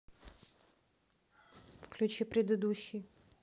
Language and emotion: Russian, neutral